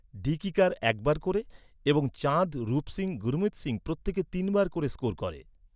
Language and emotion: Bengali, neutral